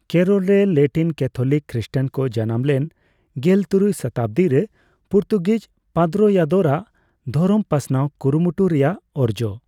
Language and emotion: Santali, neutral